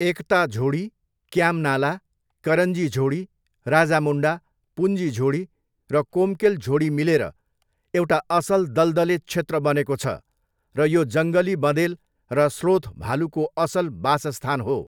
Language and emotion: Nepali, neutral